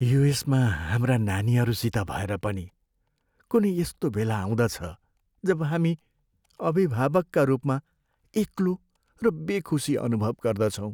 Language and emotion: Nepali, sad